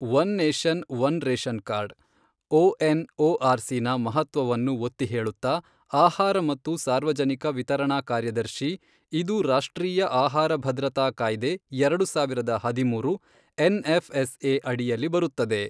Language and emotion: Kannada, neutral